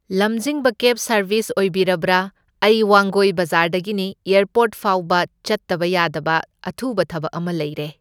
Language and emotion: Manipuri, neutral